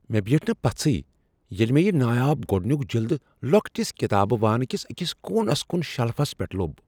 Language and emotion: Kashmiri, surprised